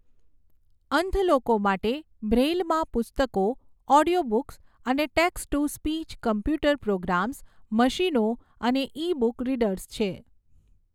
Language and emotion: Gujarati, neutral